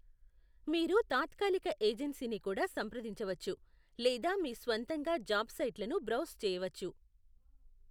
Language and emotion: Telugu, neutral